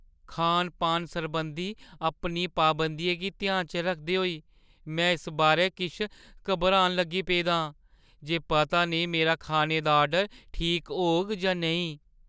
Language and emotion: Dogri, fearful